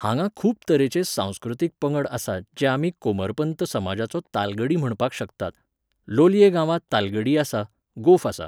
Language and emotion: Goan Konkani, neutral